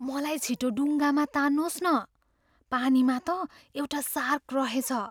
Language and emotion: Nepali, fearful